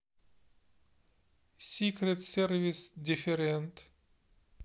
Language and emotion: Russian, neutral